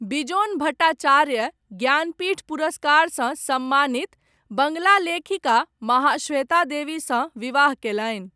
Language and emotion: Maithili, neutral